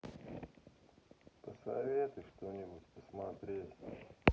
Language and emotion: Russian, sad